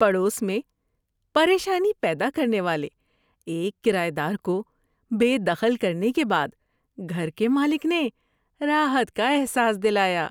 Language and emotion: Urdu, happy